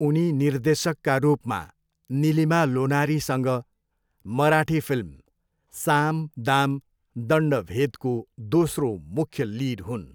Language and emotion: Nepali, neutral